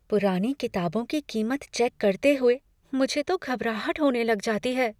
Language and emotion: Hindi, fearful